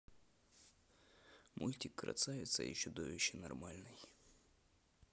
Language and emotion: Russian, neutral